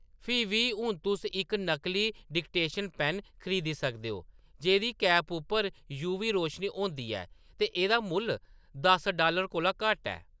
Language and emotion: Dogri, neutral